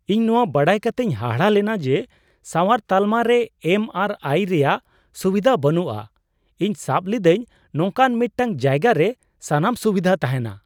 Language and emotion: Santali, surprised